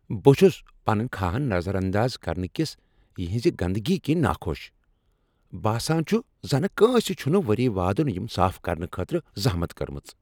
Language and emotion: Kashmiri, angry